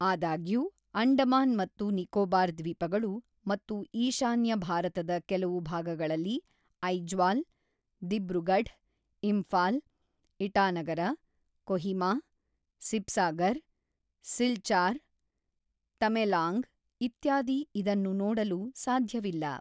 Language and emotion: Kannada, neutral